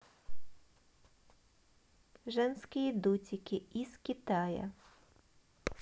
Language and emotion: Russian, neutral